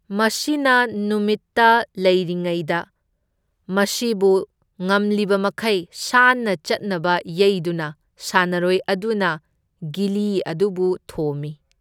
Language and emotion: Manipuri, neutral